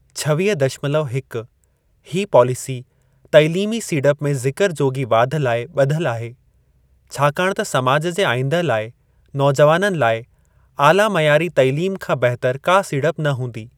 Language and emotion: Sindhi, neutral